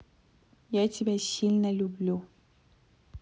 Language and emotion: Russian, neutral